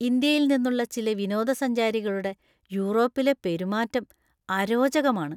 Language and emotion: Malayalam, disgusted